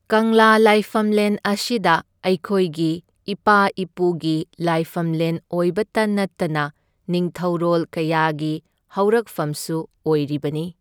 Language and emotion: Manipuri, neutral